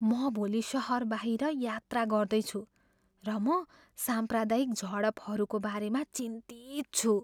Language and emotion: Nepali, fearful